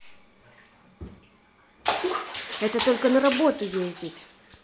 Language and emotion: Russian, angry